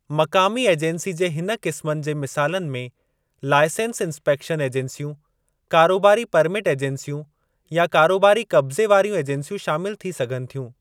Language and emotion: Sindhi, neutral